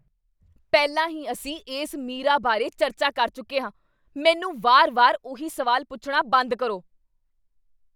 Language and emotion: Punjabi, angry